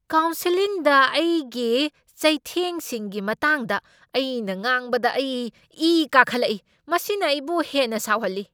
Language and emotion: Manipuri, angry